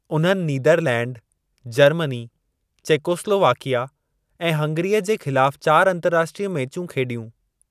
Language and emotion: Sindhi, neutral